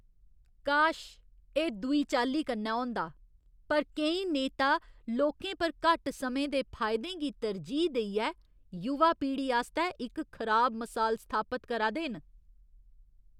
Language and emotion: Dogri, disgusted